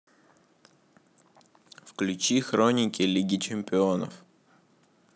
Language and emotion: Russian, neutral